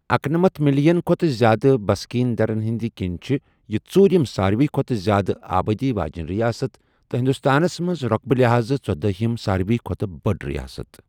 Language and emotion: Kashmiri, neutral